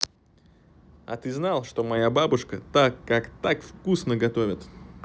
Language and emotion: Russian, positive